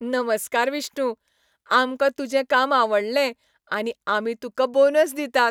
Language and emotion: Goan Konkani, happy